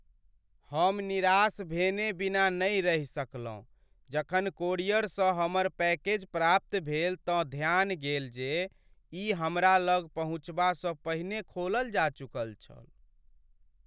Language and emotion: Maithili, sad